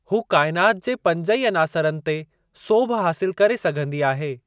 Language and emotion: Sindhi, neutral